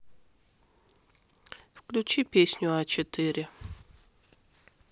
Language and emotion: Russian, neutral